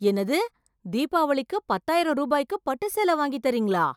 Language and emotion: Tamil, surprised